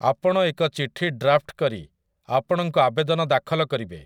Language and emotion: Odia, neutral